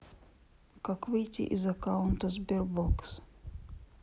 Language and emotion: Russian, sad